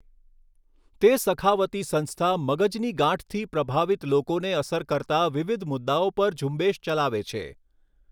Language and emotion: Gujarati, neutral